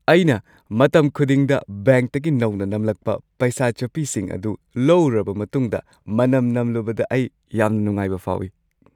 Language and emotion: Manipuri, happy